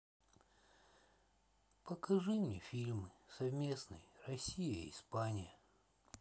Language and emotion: Russian, sad